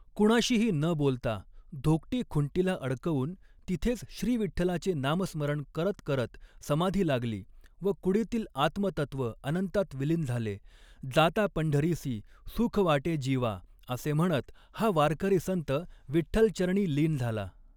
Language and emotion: Marathi, neutral